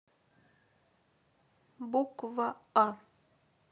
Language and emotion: Russian, neutral